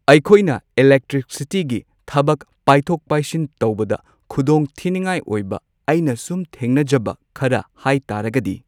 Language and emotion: Manipuri, neutral